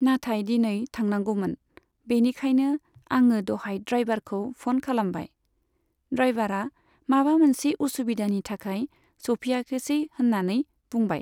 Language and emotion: Bodo, neutral